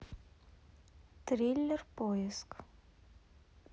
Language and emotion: Russian, neutral